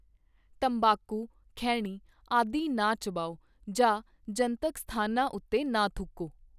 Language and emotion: Punjabi, neutral